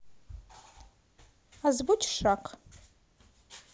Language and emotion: Russian, neutral